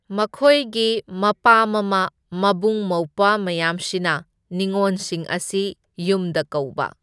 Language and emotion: Manipuri, neutral